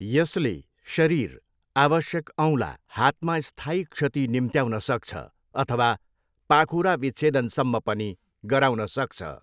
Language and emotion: Nepali, neutral